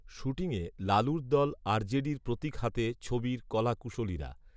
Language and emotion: Bengali, neutral